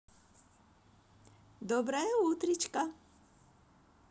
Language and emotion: Russian, positive